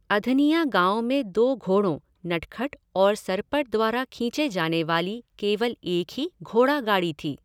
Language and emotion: Hindi, neutral